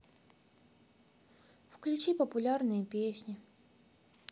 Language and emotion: Russian, sad